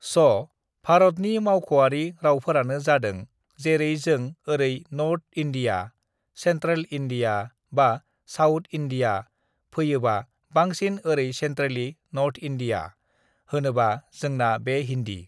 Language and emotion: Bodo, neutral